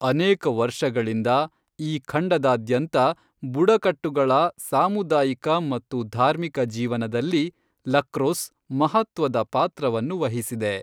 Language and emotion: Kannada, neutral